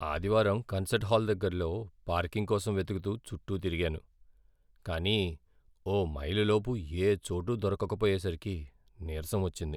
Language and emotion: Telugu, sad